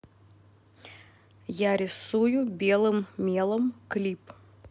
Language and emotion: Russian, neutral